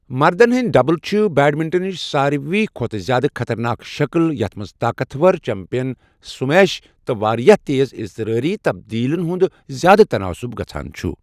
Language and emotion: Kashmiri, neutral